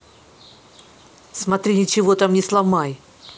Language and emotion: Russian, angry